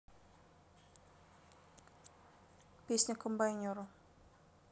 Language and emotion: Russian, neutral